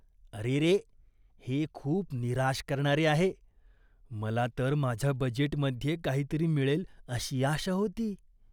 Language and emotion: Marathi, disgusted